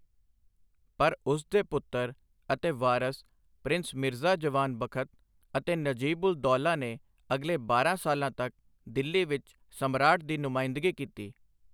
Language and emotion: Punjabi, neutral